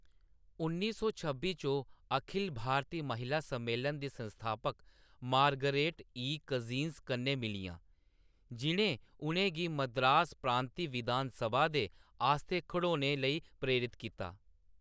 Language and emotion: Dogri, neutral